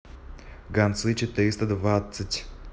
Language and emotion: Russian, neutral